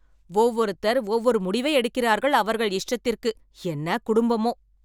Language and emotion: Tamil, angry